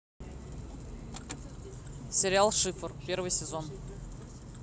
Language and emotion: Russian, neutral